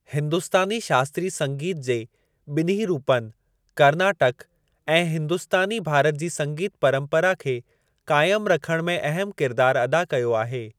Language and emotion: Sindhi, neutral